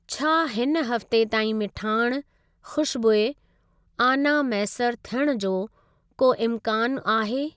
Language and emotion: Sindhi, neutral